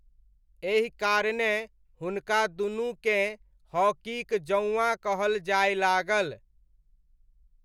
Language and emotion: Maithili, neutral